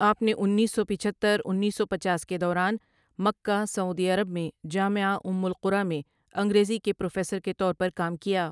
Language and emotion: Urdu, neutral